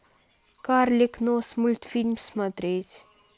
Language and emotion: Russian, neutral